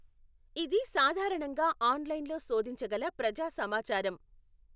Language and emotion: Telugu, neutral